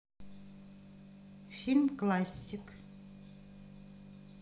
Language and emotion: Russian, neutral